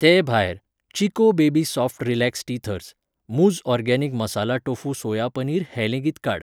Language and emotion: Goan Konkani, neutral